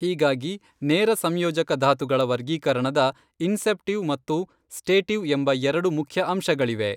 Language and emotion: Kannada, neutral